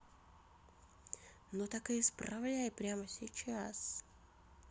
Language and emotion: Russian, neutral